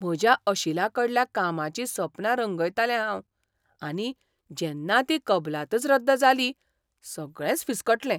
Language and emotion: Goan Konkani, surprised